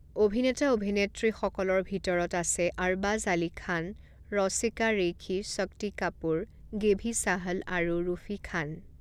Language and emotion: Assamese, neutral